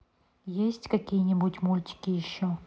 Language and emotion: Russian, neutral